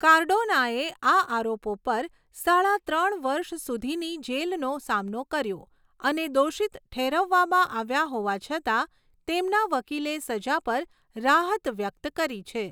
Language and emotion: Gujarati, neutral